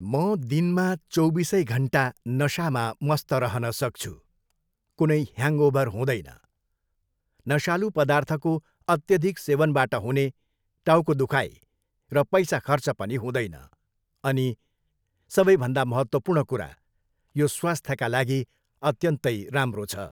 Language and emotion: Nepali, neutral